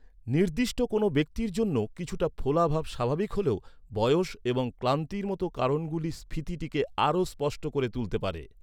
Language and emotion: Bengali, neutral